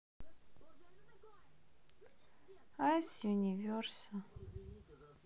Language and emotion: Russian, sad